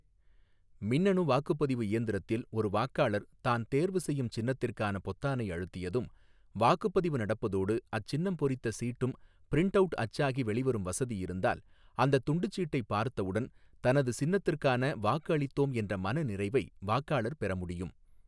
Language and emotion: Tamil, neutral